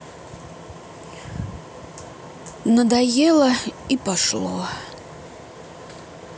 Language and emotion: Russian, sad